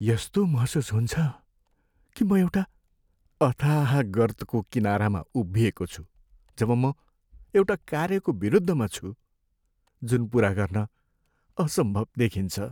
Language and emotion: Nepali, sad